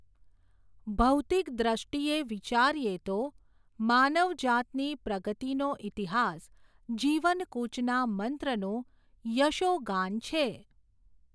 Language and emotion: Gujarati, neutral